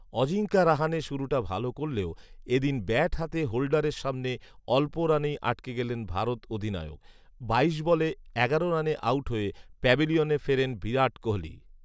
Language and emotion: Bengali, neutral